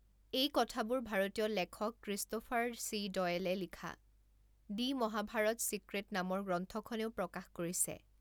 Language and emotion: Assamese, neutral